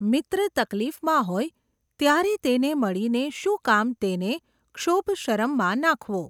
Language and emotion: Gujarati, neutral